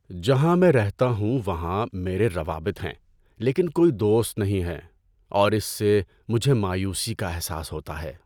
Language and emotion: Urdu, sad